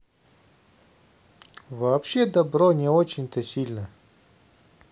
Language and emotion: Russian, neutral